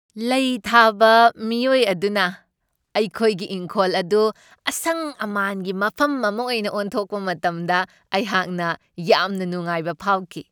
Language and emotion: Manipuri, happy